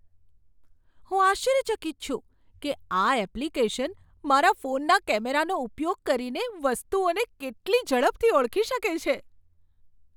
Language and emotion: Gujarati, surprised